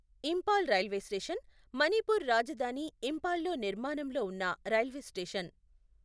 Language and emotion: Telugu, neutral